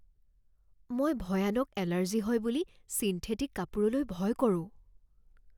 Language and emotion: Assamese, fearful